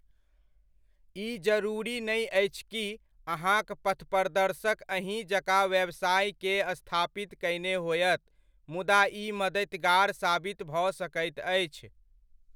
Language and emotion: Maithili, neutral